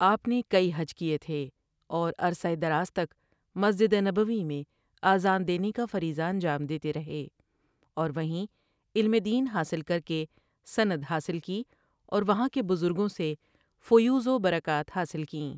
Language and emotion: Urdu, neutral